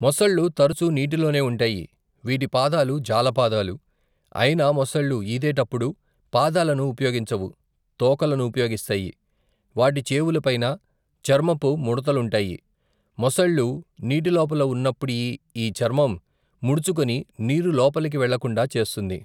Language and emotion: Telugu, neutral